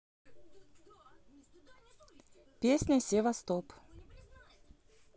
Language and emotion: Russian, neutral